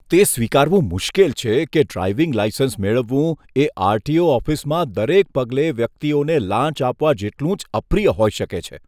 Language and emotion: Gujarati, disgusted